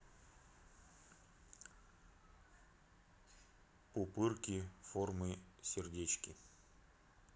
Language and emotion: Russian, neutral